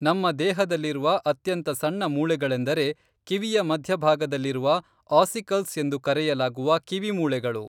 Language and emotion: Kannada, neutral